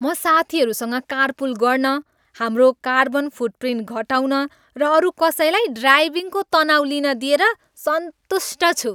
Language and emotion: Nepali, happy